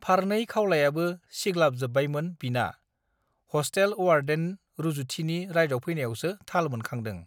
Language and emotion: Bodo, neutral